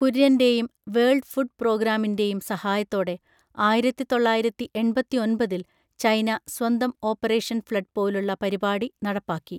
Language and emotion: Malayalam, neutral